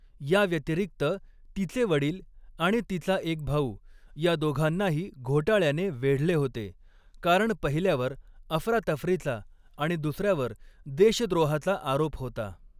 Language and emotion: Marathi, neutral